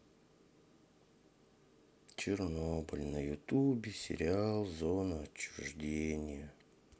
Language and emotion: Russian, sad